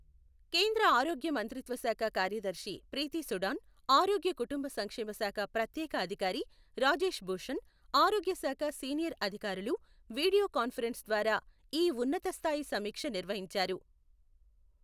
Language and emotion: Telugu, neutral